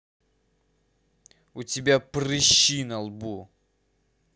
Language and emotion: Russian, angry